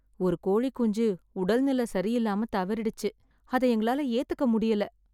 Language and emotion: Tamil, sad